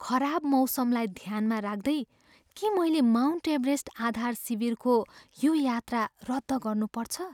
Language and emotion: Nepali, fearful